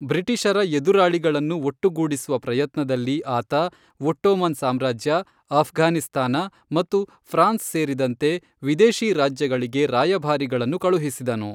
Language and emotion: Kannada, neutral